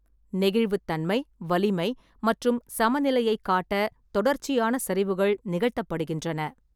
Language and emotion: Tamil, neutral